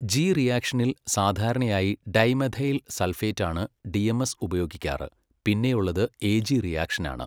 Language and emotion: Malayalam, neutral